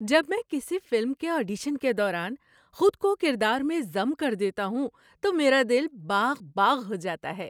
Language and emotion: Urdu, happy